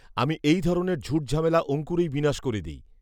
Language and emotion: Bengali, neutral